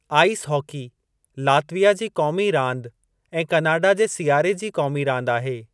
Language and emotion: Sindhi, neutral